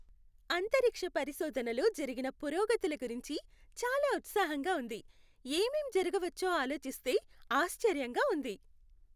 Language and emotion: Telugu, happy